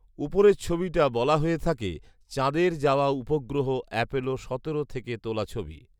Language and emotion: Bengali, neutral